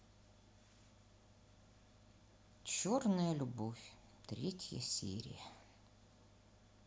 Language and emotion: Russian, sad